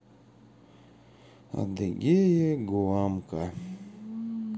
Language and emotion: Russian, sad